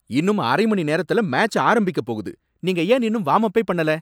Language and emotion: Tamil, angry